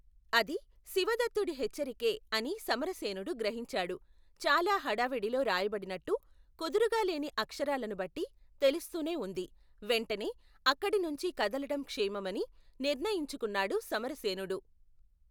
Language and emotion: Telugu, neutral